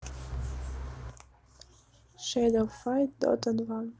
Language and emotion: Russian, neutral